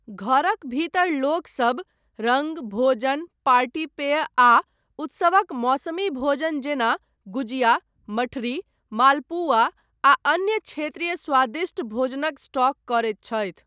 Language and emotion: Maithili, neutral